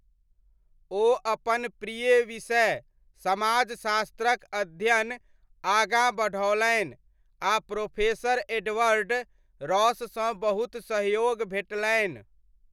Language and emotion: Maithili, neutral